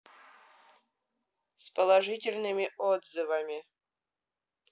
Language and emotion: Russian, neutral